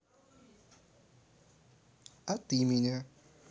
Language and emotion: Russian, neutral